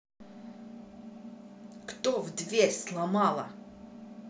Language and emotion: Russian, angry